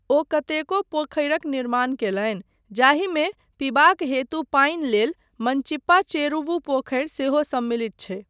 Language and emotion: Maithili, neutral